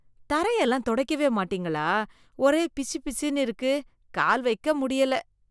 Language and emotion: Tamil, disgusted